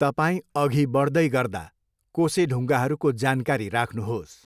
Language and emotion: Nepali, neutral